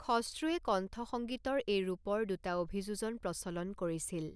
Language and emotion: Assamese, neutral